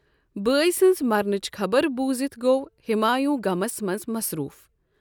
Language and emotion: Kashmiri, neutral